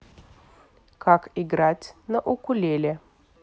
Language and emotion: Russian, neutral